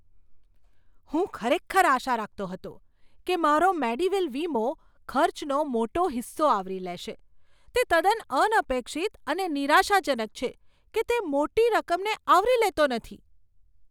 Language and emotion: Gujarati, surprised